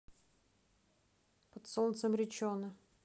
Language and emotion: Russian, neutral